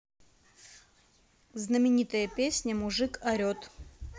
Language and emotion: Russian, neutral